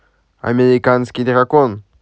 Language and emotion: Russian, positive